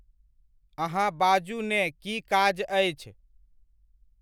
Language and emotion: Maithili, neutral